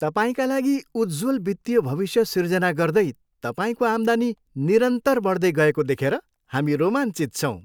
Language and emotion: Nepali, happy